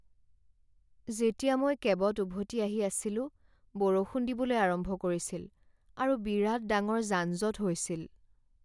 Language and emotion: Assamese, sad